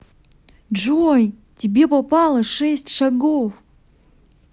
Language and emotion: Russian, positive